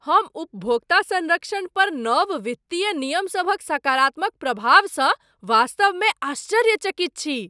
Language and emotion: Maithili, surprised